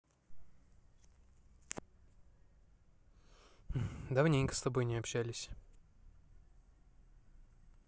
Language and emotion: Russian, neutral